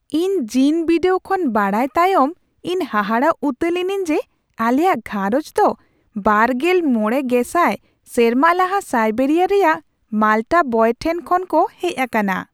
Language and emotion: Santali, surprised